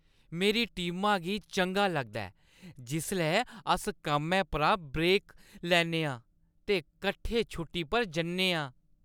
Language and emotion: Dogri, happy